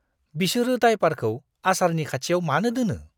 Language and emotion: Bodo, disgusted